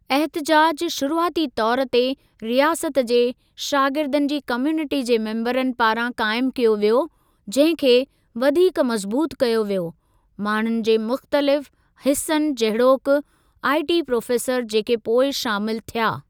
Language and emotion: Sindhi, neutral